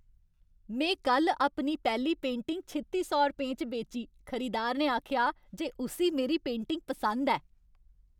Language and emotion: Dogri, happy